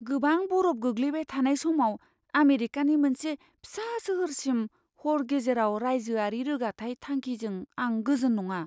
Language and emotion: Bodo, fearful